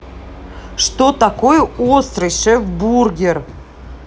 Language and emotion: Russian, angry